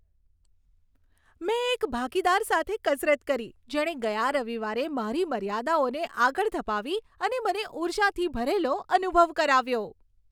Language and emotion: Gujarati, happy